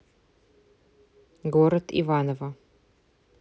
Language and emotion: Russian, neutral